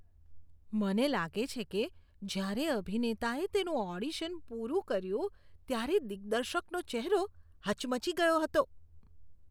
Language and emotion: Gujarati, disgusted